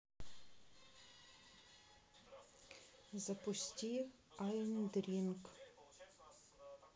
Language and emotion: Russian, neutral